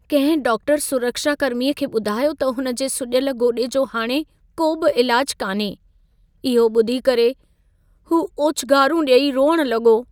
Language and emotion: Sindhi, sad